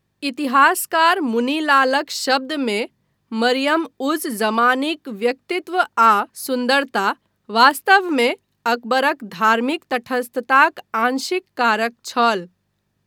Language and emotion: Maithili, neutral